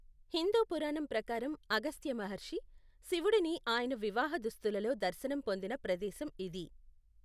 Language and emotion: Telugu, neutral